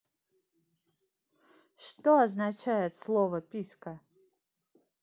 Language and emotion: Russian, neutral